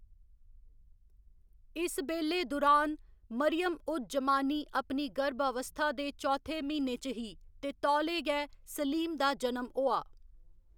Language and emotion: Dogri, neutral